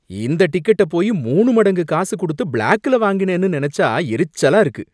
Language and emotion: Tamil, angry